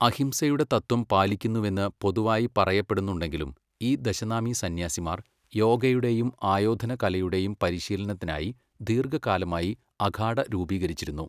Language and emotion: Malayalam, neutral